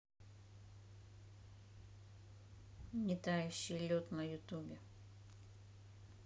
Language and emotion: Russian, neutral